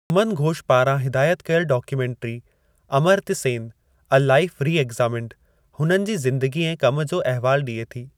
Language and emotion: Sindhi, neutral